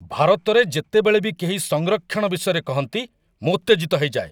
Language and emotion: Odia, angry